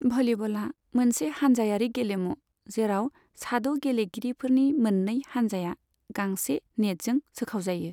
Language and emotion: Bodo, neutral